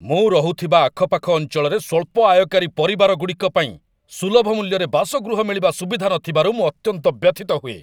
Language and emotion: Odia, angry